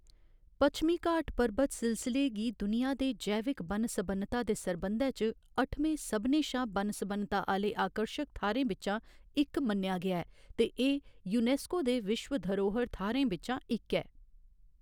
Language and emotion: Dogri, neutral